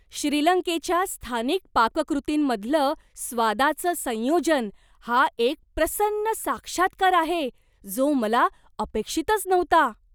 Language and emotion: Marathi, surprised